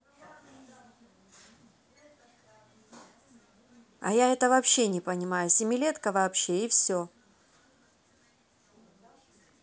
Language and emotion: Russian, neutral